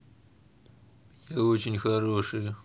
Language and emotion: Russian, neutral